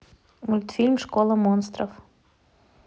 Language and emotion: Russian, neutral